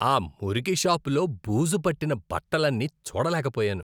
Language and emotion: Telugu, disgusted